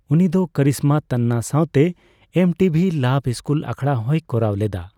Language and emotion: Santali, neutral